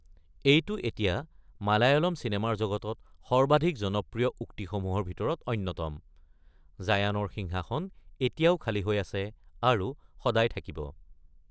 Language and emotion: Assamese, neutral